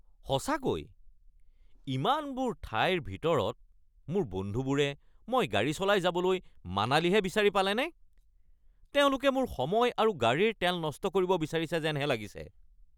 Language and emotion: Assamese, angry